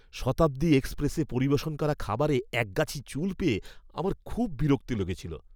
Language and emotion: Bengali, disgusted